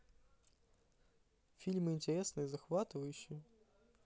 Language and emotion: Russian, positive